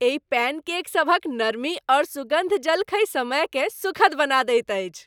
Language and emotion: Maithili, happy